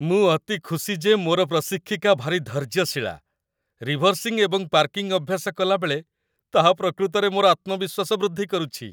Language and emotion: Odia, happy